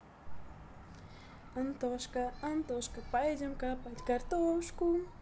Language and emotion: Russian, positive